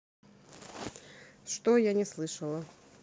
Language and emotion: Russian, neutral